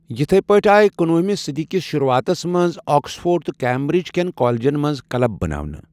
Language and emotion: Kashmiri, neutral